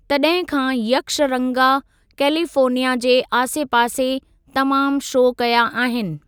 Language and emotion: Sindhi, neutral